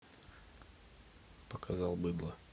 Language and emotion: Russian, neutral